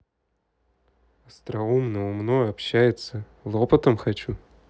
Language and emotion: Russian, neutral